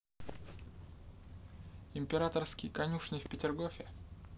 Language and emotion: Russian, neutral